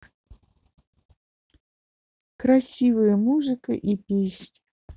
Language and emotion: Russian, neutral